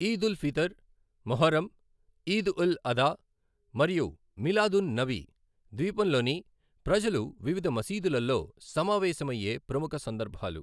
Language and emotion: Telugu, neutral